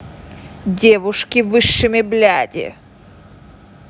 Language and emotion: Russian, angry